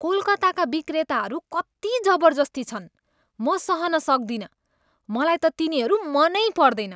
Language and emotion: Nepali, disgusted